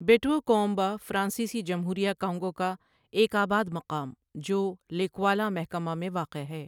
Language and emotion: Urdu, neutral